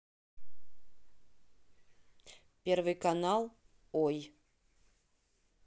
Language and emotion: Russian, neutral